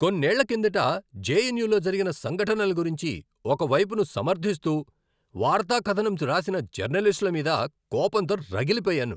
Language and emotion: Telugu, angry